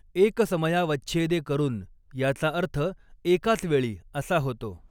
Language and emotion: Marathi, neutral